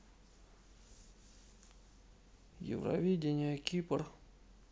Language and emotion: Russian, neutral